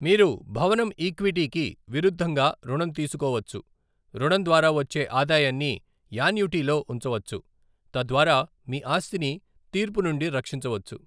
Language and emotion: Telugu, neutral